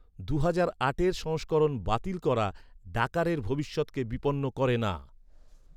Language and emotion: Bengali, neutral